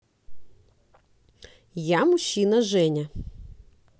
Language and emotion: Russian, positive